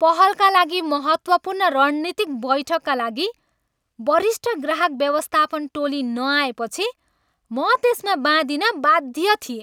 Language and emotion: Nepali, angry